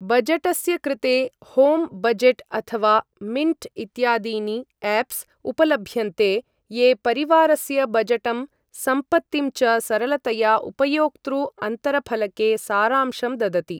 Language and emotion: Sanskrit, neutral